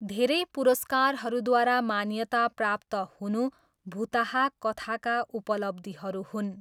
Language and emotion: Nepali, neutral